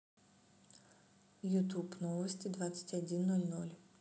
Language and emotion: Russian, neutral